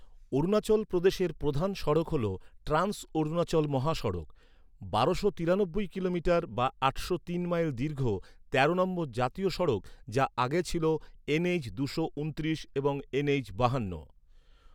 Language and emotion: Bengali, neutral